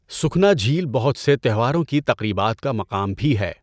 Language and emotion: Urdu, neutral